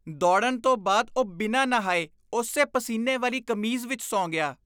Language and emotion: Punjabi, disgusted